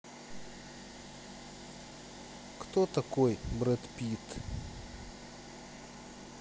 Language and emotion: Russian, neutral